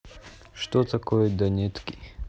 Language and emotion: Russian, neutral